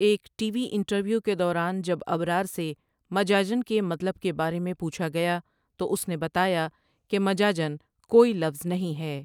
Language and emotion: Urdu, neutral